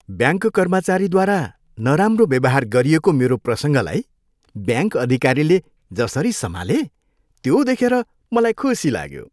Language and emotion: Nepali, happy